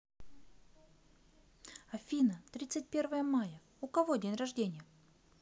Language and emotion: Russian, neutral